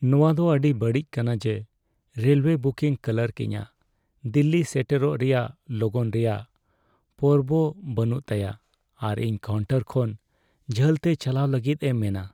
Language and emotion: Santali, sad